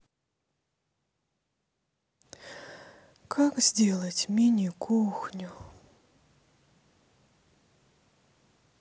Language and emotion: Russian, sad